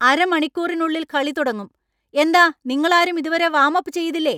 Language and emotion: Malayalam, angry